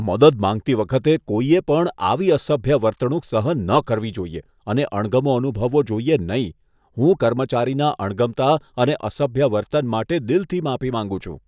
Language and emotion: Gujarati, disgusted